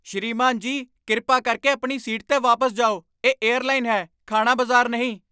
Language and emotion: Punjabi, angry